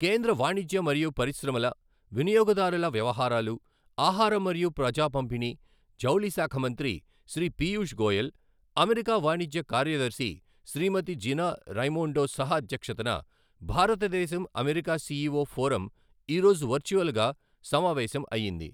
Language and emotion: Telugu, neutral